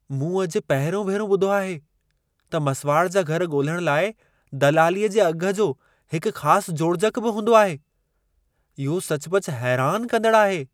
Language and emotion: Sindhi, surprised